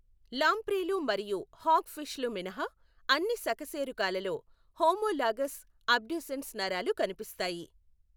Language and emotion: Telugu, neutral